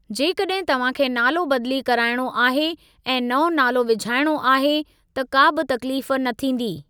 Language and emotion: Sindhi, neutral